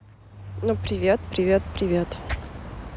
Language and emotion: Russian, neutral